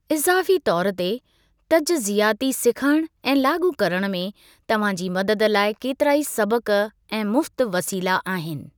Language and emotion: Sindhi, neutral